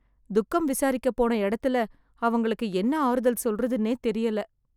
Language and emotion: Tamil, sad